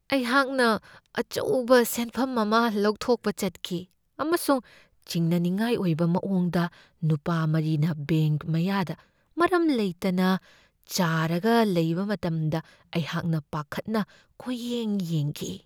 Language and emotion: Manipuri, fearful